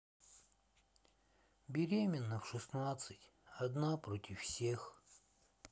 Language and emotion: Russian, sad